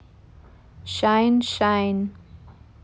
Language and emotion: Russian, neutral